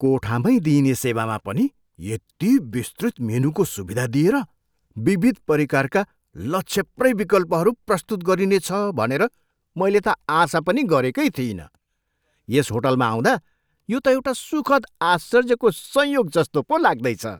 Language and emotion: Nepali, surprised